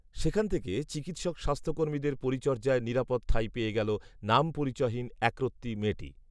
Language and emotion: Bengali, neutral